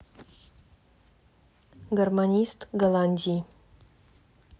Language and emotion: Russian, neutral